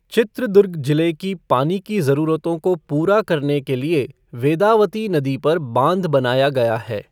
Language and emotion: Hindi, neutral